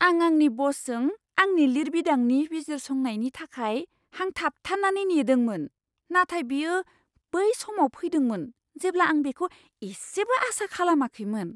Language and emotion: Bodo, surprised